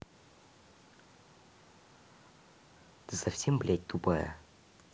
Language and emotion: Russian, angry